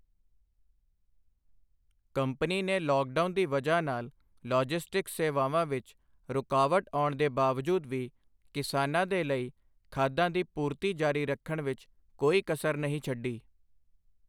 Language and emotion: Punjabi, neutral